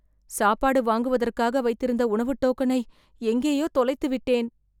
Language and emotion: Tamil, fearful